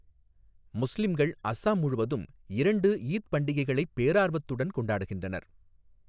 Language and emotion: Tamil, neutral